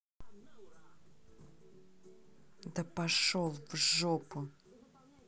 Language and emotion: Russian, angry